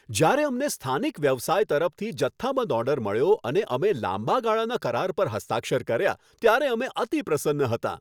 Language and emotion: Gujarati, happy